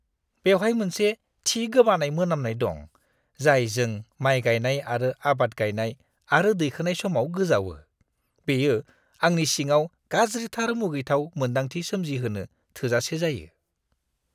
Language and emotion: Bodo, disgusted